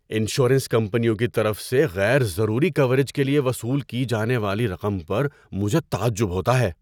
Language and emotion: Urdu, surprised